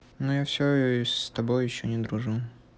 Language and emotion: Russian, sad